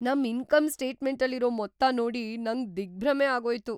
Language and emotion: Kannada, surprised